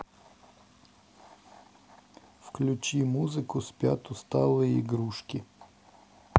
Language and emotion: Russian, neutral